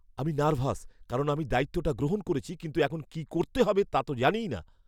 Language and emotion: Bengali, fearful